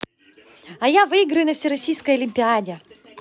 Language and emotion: Russian, positive